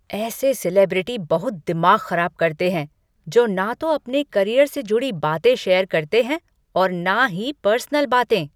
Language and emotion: Hindi, angry